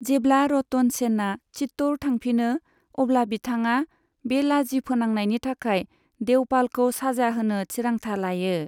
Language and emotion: Bodo, neutral